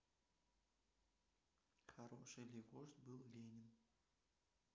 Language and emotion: Russian, neutral